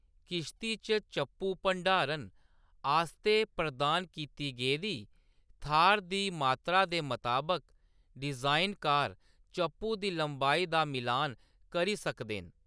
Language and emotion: Dogri, neutral